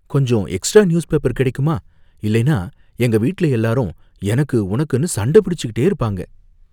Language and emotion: Tamil, fearful